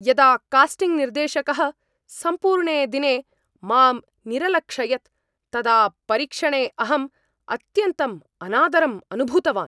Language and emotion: Sanskrit, angry